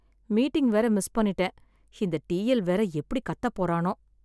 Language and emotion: Tamil, sad